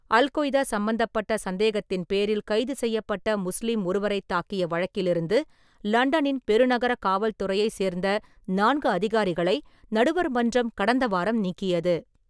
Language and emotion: Tamil, neutral